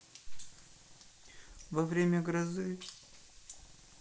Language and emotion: Russian, sad